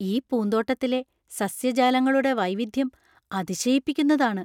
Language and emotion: Malayalam, surprised